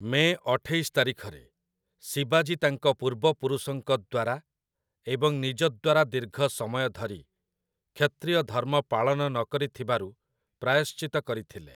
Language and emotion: Odia, neutral